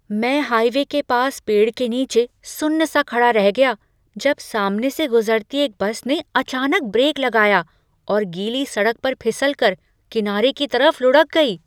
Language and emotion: Hindi, surprised